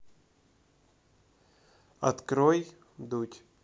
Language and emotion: Russian, neutral